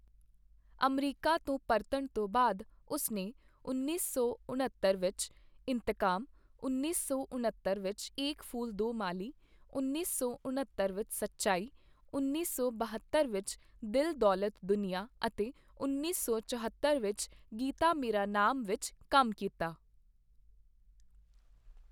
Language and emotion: Punjabi, neutral